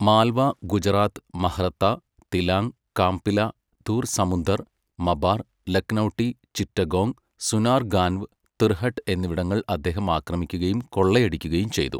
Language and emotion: Malayalam, neutral